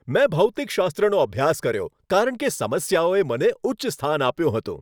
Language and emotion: Gujarati, happy